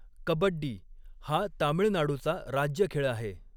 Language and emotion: Marathi, neutral